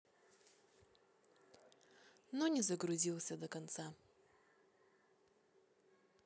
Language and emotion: Russian, neutral